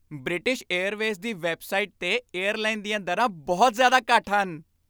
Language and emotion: Punjabi, happy